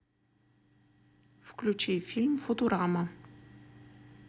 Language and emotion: Russian, neutral